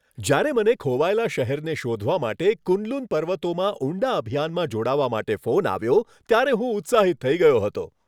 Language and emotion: Gujarati, happy